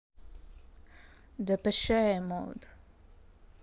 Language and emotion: Russian, neutral